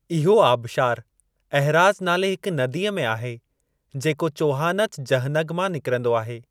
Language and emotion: Sindhi, neutral